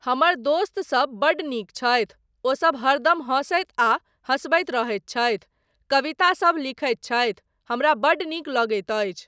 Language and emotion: Maithili, neutral